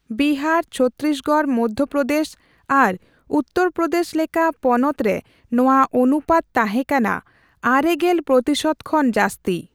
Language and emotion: Santali, neutral